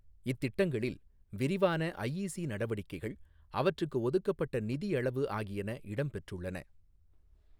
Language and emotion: Tamil, neutral